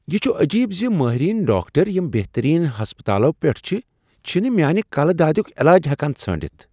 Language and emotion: Kashmiri, surprised